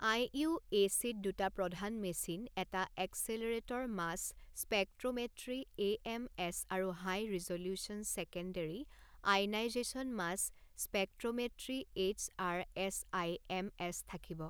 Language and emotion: Assamese, neutral